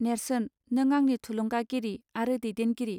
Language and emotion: Bodo, neutral